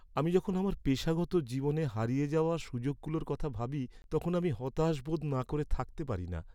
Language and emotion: Bengali, sad